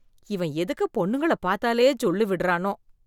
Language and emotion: Tamil, disgusted